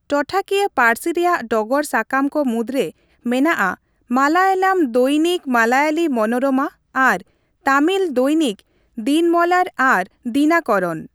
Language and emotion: Santali, neutral